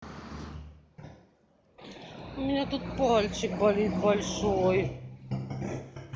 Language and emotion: Russian, sad